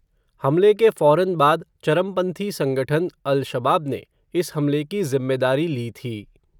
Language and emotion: Hindi, neutral